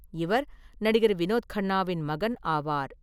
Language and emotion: Tamil, neutral